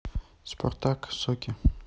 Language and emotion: Russian, neutral